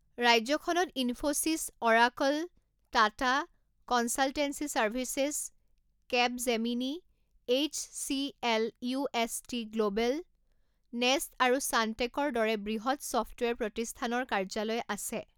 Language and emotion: Assamese, neutral